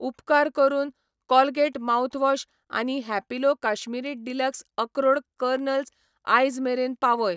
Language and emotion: Goan Konkani, neutral